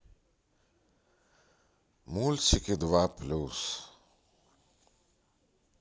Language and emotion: Russian, sad